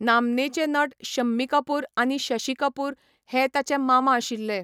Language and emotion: Goan Konkani, neutral